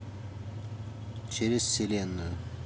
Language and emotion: Russian, neutral